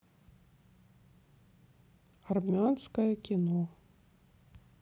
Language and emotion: Russian, sad